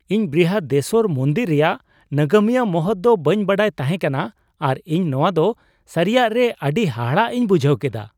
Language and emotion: Santali, surprised